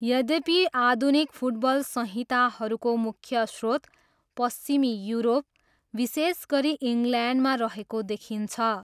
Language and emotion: Nepali, neutral